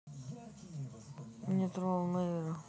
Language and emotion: Russian, sad